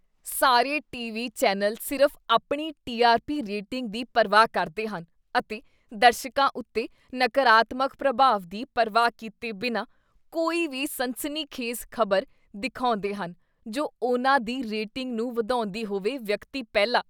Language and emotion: Punjabi, disgusted